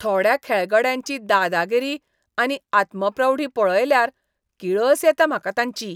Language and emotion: Goan Konkani, disgusted